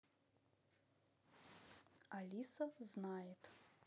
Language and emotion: Russian, neutral